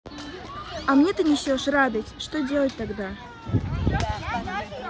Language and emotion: Russian, neutral